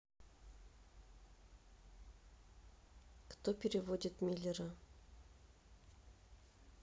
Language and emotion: Russian, neutral